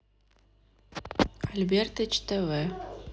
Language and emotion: Russian, neutral